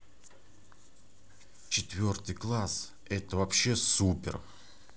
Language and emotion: Russian, positive